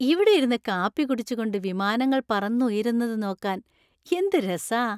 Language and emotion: Malayalam, happy